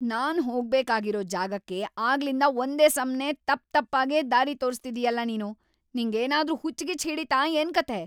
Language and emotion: Kannada, angry